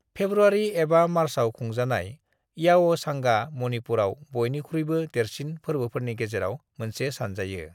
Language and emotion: Bodo, neutral